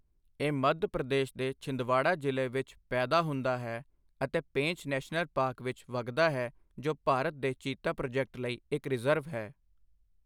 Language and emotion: Punjabi, neutral